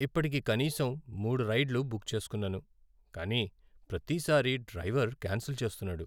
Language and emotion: Telugu, sad